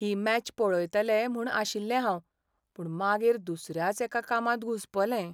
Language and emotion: Goan Konkani, sad